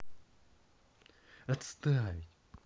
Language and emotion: Russian, angry